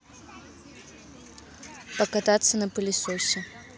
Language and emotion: Russian, neutral